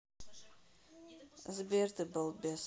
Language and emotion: Russian, neutral